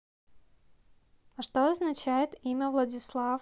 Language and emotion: Russian, neutral